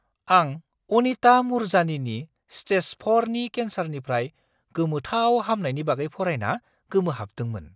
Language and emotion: Bodo, surprised